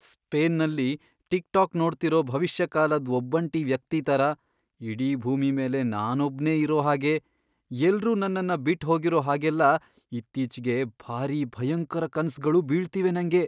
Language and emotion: Kannada, fearful